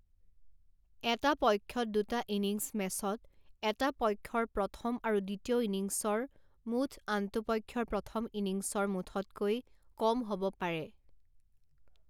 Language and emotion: Assamese, neutral